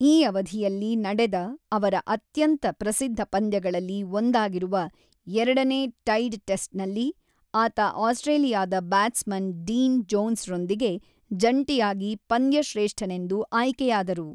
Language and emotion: Kannada, neutral